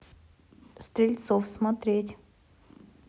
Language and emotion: Russian, neutral